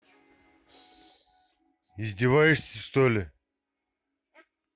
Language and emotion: Russian, angry